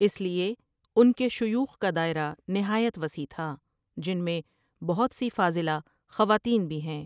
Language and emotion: Urdu, neutral